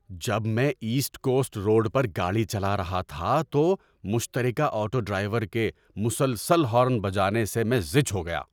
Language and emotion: Urdu, angry